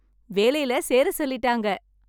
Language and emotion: Tamil, happy